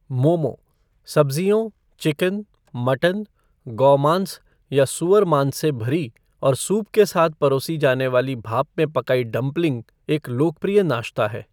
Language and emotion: Hindi, neutral